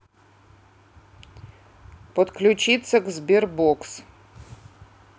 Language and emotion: Russian, neutral